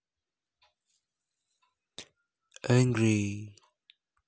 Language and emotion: Russian, neutral